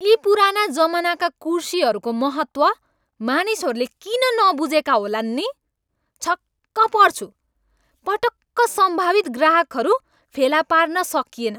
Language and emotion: Nepali, angry